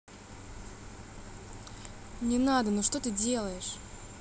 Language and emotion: Russian, angry